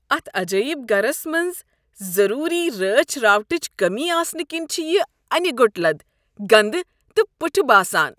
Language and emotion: Kashmiri, disgusted